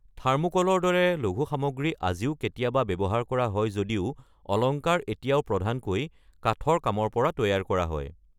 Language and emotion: Assamese, neutral